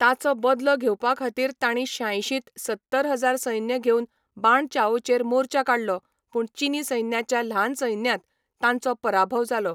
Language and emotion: Goan Konkani, neutral